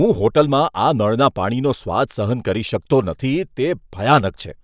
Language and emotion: Gujarati, disgusted